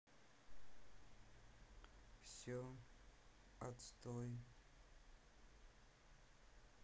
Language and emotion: Russian, sad